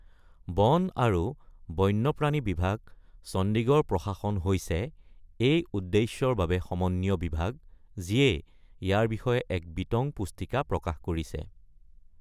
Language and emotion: Assamese, neutral